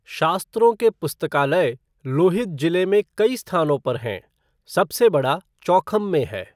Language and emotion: Hindi, neutral